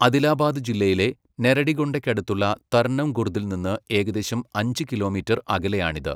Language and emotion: Malayalam, neutral